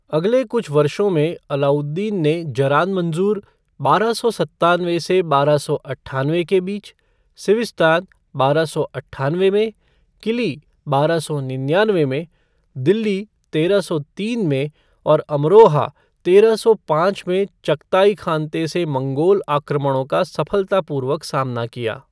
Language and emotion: Hindi, neutral